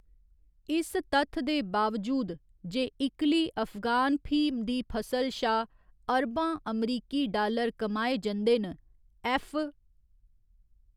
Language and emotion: Dogri, neutral